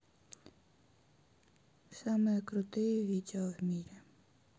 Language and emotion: Russian, sad